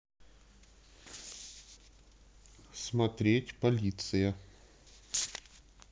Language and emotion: Russian, neutral